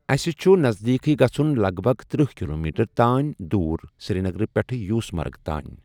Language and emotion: Kashmiri, neutral